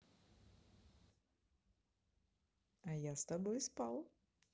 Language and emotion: Russian, positive